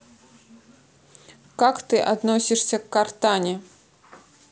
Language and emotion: Russian, neutral